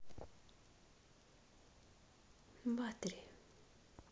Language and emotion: Russian, neutral